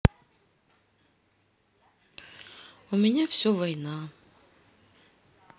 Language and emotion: Russian, sad